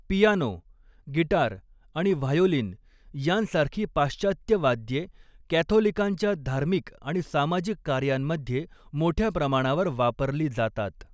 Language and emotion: Marathi, neutral